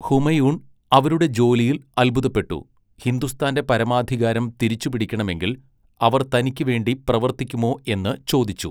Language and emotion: Malayalam, neutral